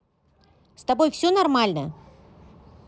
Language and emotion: Russian, neutral